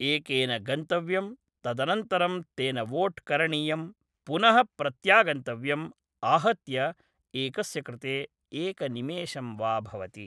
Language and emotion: Sanskrit, neutral